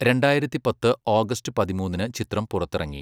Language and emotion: Malayalam, neutral